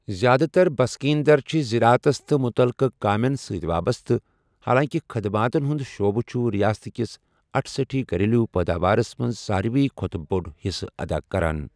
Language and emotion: Kashmiri, neutral